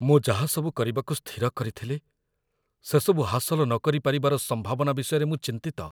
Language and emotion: Odia, fearful